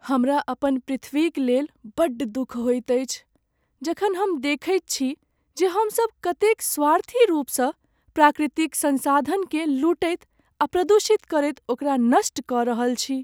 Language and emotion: Maithili, sad